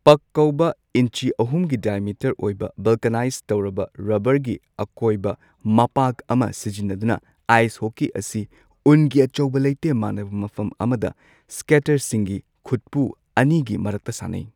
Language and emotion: Manipuri, neutral